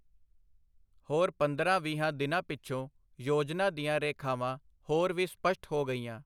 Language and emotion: Punjabi, neutral